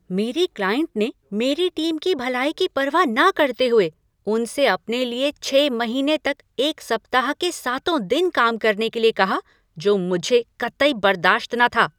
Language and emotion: Hindi, angry